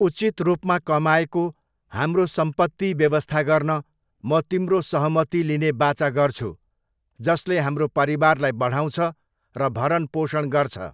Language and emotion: Nepali, neutral